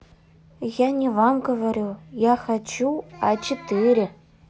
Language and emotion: Russian, neutral